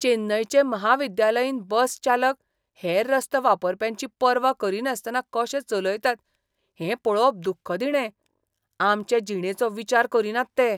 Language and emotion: Goan Konkani, disgusted